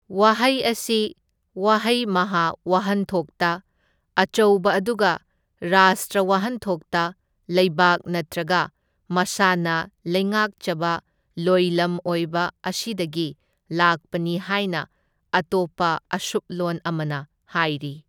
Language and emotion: Manipuri, neutral